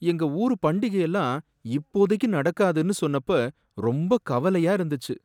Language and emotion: Tamil, sad